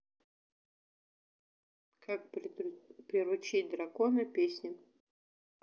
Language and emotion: Russian, neutral